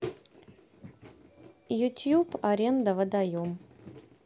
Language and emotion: Russian, neutral